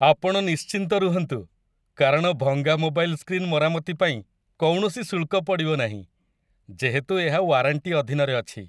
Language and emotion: Odia, happy